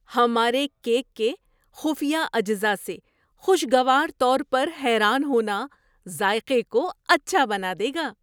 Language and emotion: Urdu, surprised